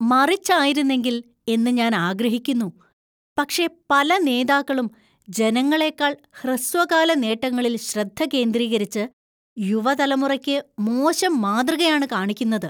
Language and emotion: Malayalam, disgusted